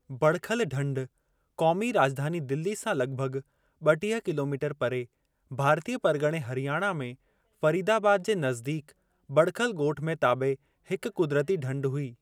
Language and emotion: Sindhi, neutral